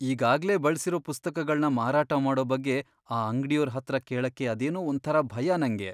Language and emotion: Kannada, fearful